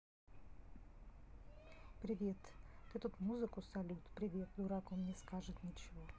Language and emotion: Russian, neutral